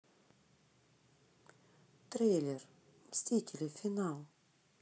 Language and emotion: Russian, neutral